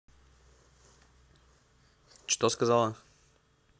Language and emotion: Russian, neutral